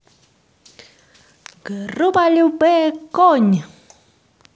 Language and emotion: Russian, positive